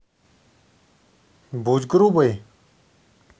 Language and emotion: Russian, neutral